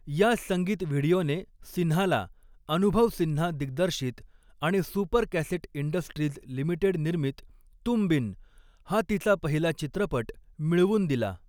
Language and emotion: Marathi, neutral